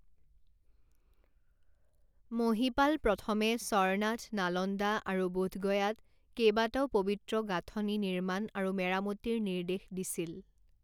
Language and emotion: Assamese, neutral